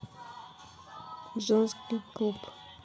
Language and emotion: Russian, neutral